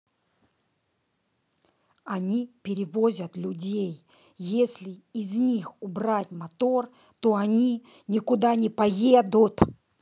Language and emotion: Russian, angry